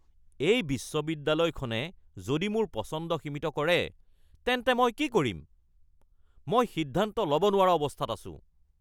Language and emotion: Assamese, angry